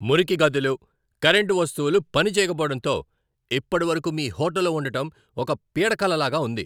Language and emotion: Telugu, angry